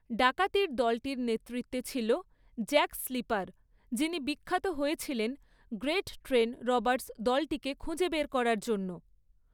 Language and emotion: Bengali, neutral